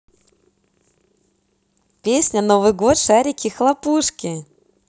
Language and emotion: Russian, positive